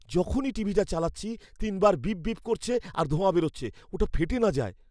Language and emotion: Bengali, fearful